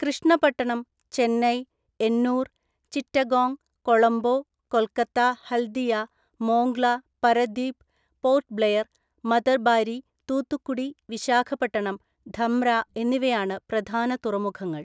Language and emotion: Malayalam, neutral